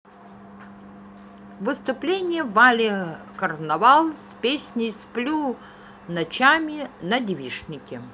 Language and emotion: Russian, positive